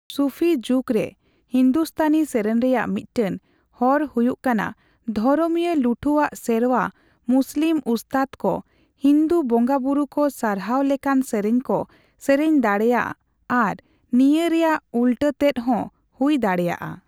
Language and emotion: Santali, neutral